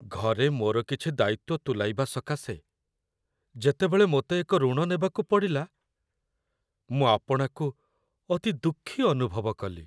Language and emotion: Odia, sad